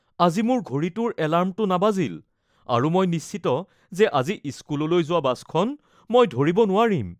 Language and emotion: Assamese, fearful